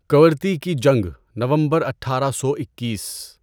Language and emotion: Urdu, neutral